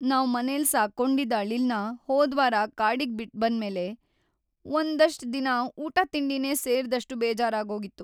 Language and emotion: Kannada, sad